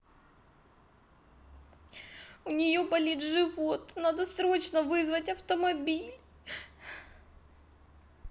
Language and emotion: Russian, sad